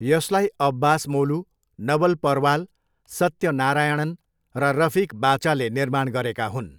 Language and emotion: Nepali, neutral